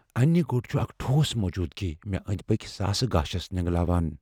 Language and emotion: Kashmiri, fearful